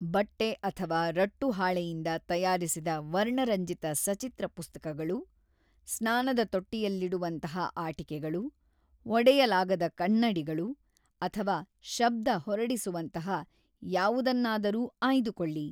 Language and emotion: Kannada, neutral